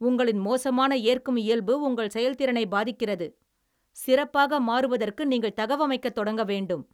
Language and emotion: Tamil, angry